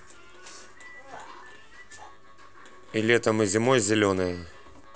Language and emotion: Russian, neutral